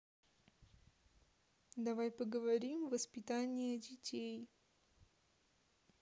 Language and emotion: Russian, neutral